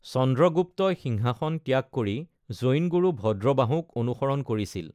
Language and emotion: Assamese, neutral